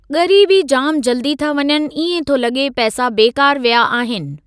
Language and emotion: Sindhi, neutral